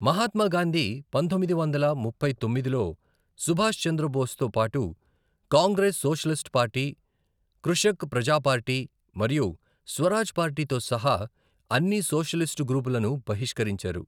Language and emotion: Telugu, neutral